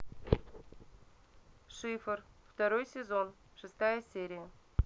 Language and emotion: Russian, neutral